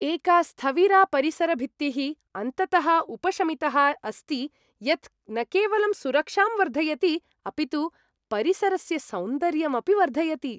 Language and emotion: Sanskrit, happy